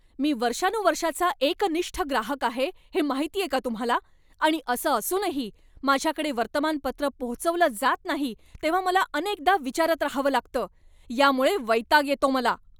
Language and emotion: Marathi, angry